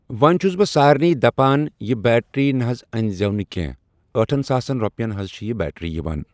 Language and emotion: Kashmiri, neutral